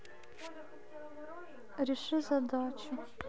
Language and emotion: Russian, sad